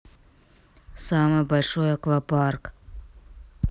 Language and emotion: Russian, neutral